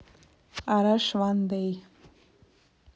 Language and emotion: Russian, neutral